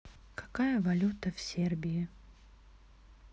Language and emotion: Russian, neutral